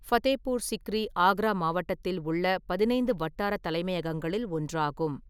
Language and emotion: Tamil, neutral